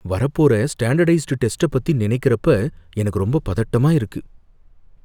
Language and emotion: Tamil, fearful